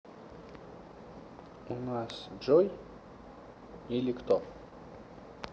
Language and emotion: Russian, neutral